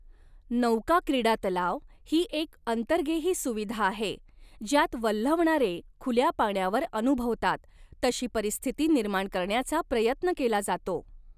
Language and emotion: Marathi, neutral